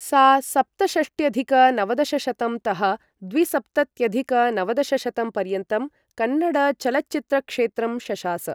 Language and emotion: Sanskrit, neutral